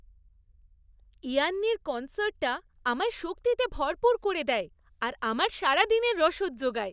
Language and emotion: Bengali, happy